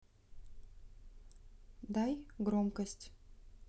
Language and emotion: Russian, neutral